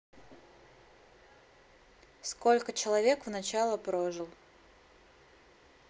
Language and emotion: Russian, neutral